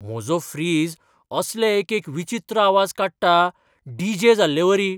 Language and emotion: Goan Konkani, surprised